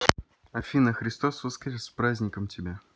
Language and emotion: Russian, positive